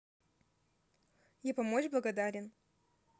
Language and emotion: Russian, neutral